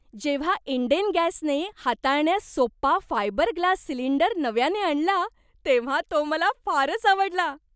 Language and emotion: Marathi, happy